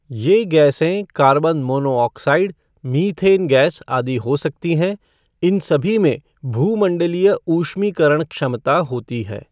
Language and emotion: Hindi, neutral